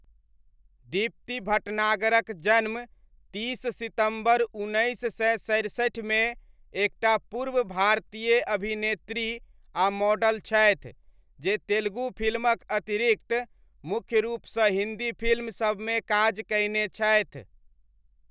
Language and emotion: Maithili, neutral